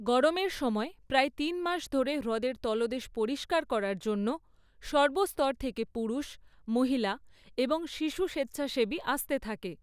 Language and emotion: Bengali, neutral